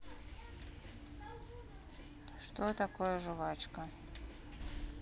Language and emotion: Russian, neutral